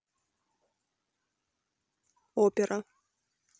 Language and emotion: Russian, neutral